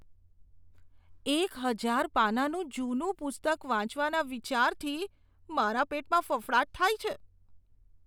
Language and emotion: Gujarati, disgusted